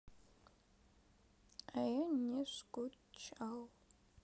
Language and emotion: Russian, sad